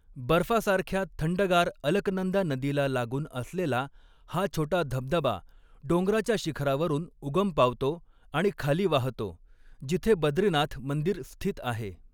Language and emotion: Marathi, neutral